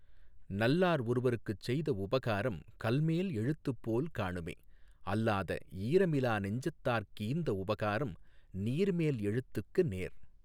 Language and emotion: Tamil, neutral